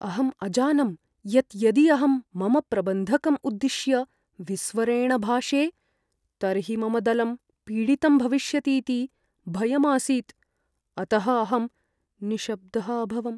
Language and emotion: Sanskrit, fearful